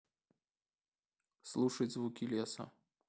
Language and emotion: Russian, neutral